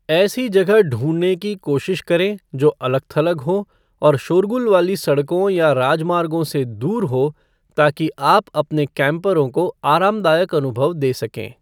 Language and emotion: Hindi, neutral